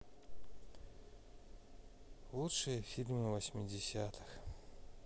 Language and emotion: Russian, sad